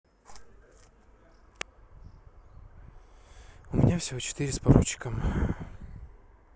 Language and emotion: Russian, sad